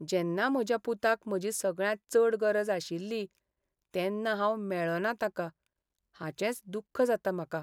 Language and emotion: Goan Konkani, sad